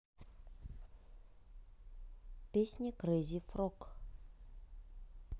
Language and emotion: Russian, neutral